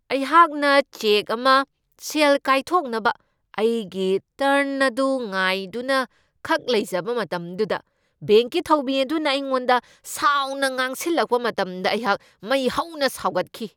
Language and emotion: Manipuri, angry